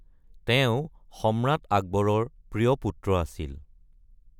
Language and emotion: Assamese, neutral